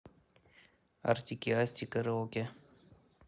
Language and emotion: Russian, neutral